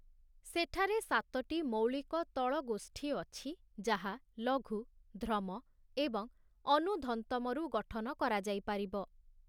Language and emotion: Odia, neutral